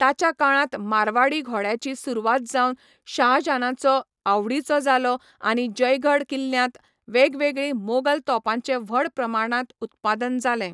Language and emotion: Goan Konkani, neutral